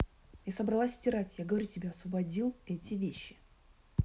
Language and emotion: Russian, angry